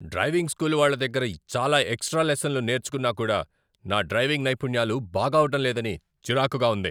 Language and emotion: Telugu, angry